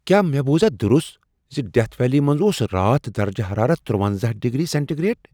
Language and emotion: Kashmiri, surprised